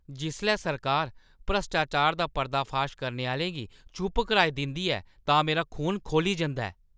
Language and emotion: Dogri, angry